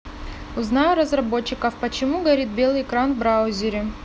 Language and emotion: Russian, neutral